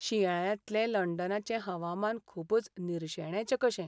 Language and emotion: Goan Konkani, sad